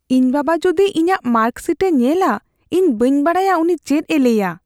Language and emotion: Santali, fearful